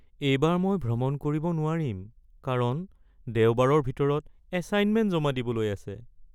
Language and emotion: Assamese, sad